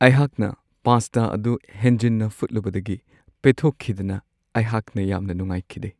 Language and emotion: Manipuri, sad